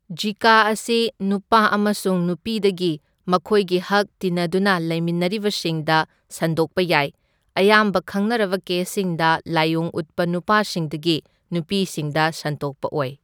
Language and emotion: Manipuri, neutral